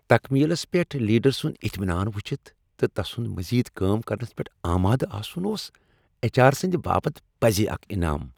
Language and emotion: Kashmiri, happy